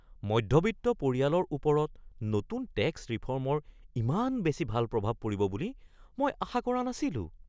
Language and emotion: Assamese, surprised